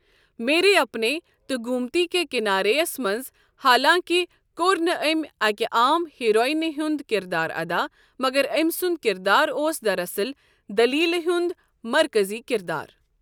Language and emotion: Kashmiri, neutral